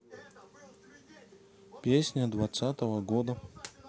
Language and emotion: Russian, neutral